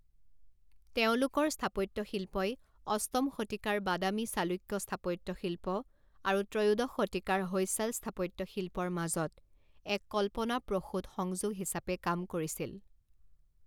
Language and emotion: Assamese, neutral